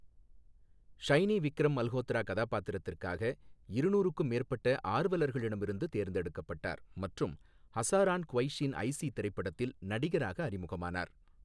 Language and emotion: Tamil, neutral